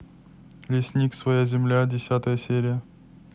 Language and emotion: Russian, neutral